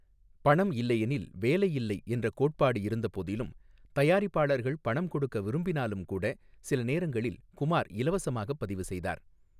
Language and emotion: Tamil, neutral